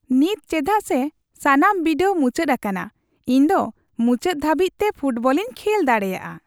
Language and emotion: Santali, happy